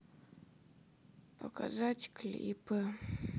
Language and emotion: Russian, sad